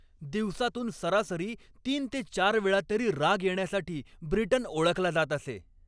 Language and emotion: Marathi, angry